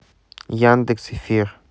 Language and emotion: Russian, neutral